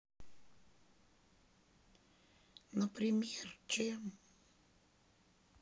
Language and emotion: Russian, sad